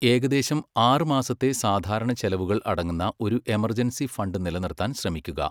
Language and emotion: Malayalam, neutral